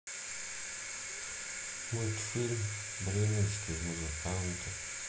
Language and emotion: Russian, sad